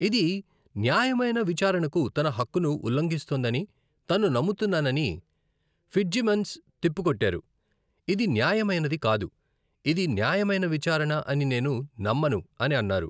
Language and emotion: Telugu, neutral